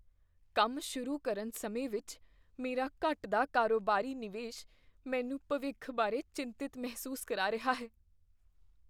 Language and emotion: Punjabi, fearful